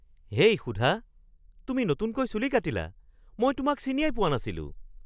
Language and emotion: Assamese, surprised